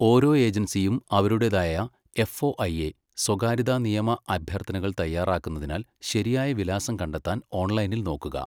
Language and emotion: Malayalam, neutral